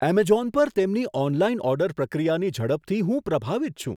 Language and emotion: Gujarati, surprised